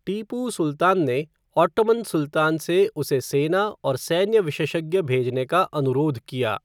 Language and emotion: Hindi, neutral